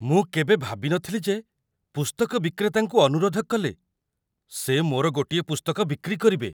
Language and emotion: Odia, surprised